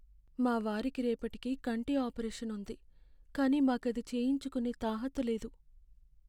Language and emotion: Telugu, sad